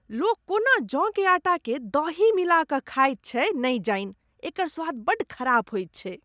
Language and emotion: Maithili, disgusted